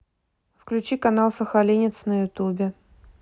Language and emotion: Russian, neutral